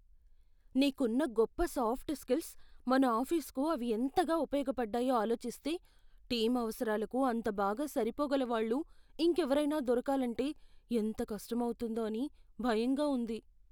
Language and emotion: Telugu, fearful